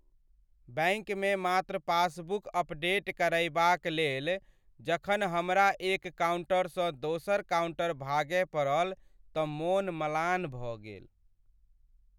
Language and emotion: Maithili, sad